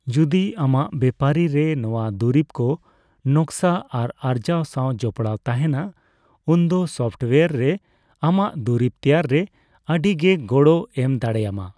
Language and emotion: Santali, neutral